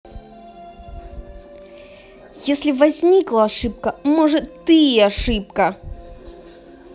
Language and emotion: Russian, angry